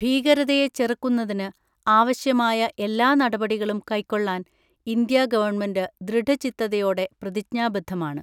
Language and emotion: Malayalam, neutral